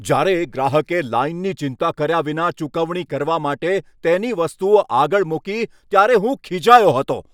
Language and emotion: Gujarati, angry